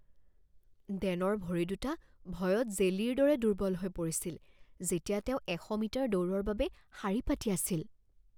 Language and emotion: Assamese, fearful